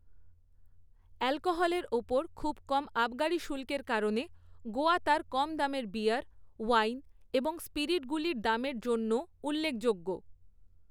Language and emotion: Bengali, neutral